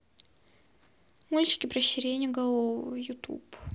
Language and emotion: Russian, sad